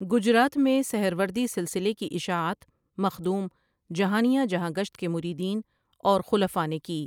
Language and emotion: Urdu, neutral